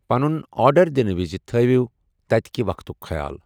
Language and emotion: Kashmiri, neutral